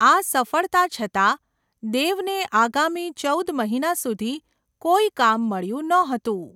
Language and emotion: Gujarati, neutral